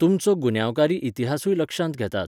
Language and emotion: Goan Konkani, neutral